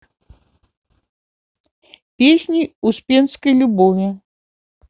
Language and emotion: Russian, neutral